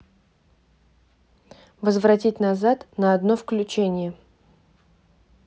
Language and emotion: Russian, neutral